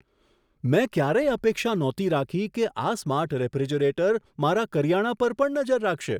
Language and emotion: Gujarati, surprised